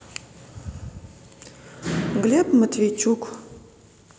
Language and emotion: Russian, neutral